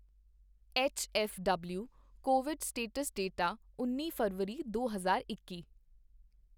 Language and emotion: Punjabi, neutral